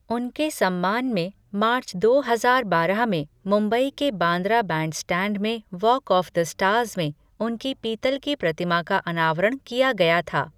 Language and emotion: Hindi, neutral